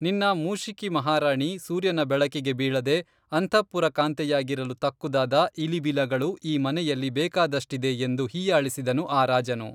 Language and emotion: Kannada, neutral